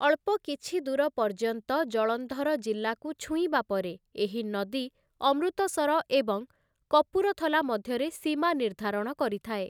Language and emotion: Odia, neutral